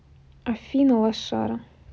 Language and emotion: Russian, neutral